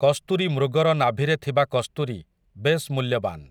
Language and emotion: Odia, neutral